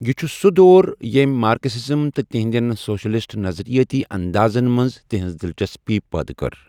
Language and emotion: Kashmiri, neutral